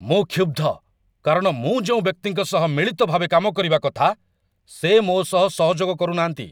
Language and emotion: Odia, angry